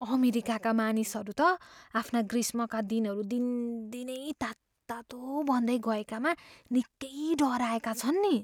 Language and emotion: Nepali, fearful